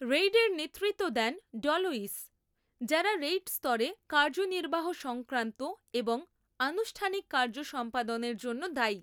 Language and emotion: Bengali, neutral